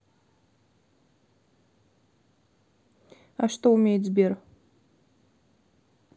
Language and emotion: Russian, neutral